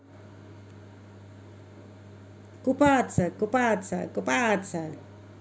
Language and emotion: Russian, positive